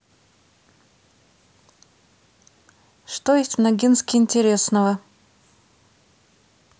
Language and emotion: Russian, neutral